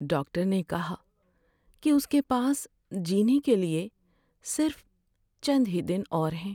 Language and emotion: Urdu, sad